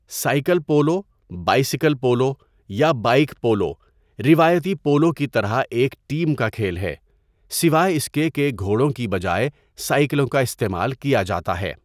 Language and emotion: Urdu, neutral